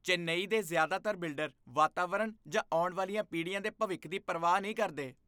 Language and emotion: Punjabi, disgusted